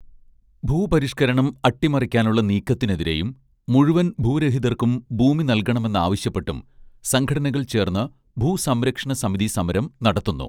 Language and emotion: Malayalam, neutral